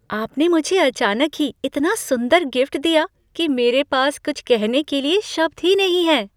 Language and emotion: Hindi, surprised